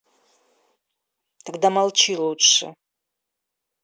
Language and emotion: Russian, angry